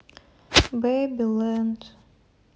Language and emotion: Russian, sad